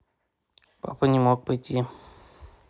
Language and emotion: Russian, neutral